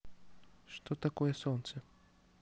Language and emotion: Russian, neutral